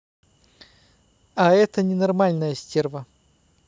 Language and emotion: Russian, neutral